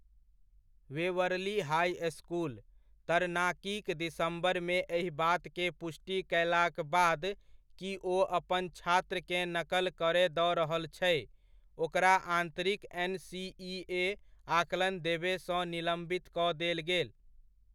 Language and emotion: Maithili, neutral